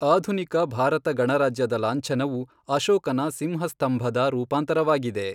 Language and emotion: Kannada, neutral